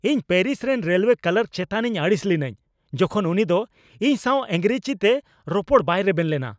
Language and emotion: Santali, angry